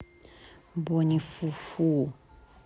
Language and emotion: Russian, neutral